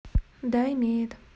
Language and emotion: Russian, neutral